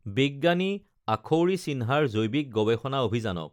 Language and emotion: Assamese, neutral